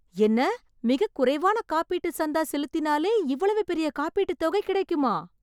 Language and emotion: Tamil, surprised